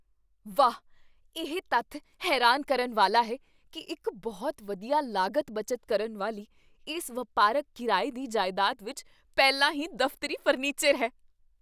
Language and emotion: Punjabi, surprised